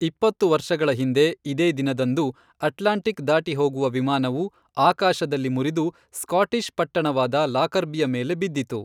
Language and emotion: Kannada, neutral